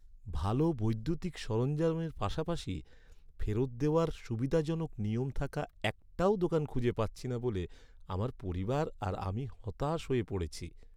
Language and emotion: Bengali, sad